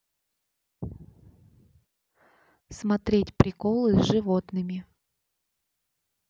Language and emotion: Russian, neutral